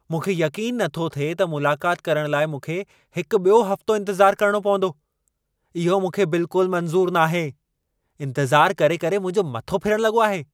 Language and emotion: Sindhi, angry